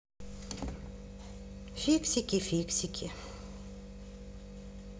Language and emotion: Russian, sad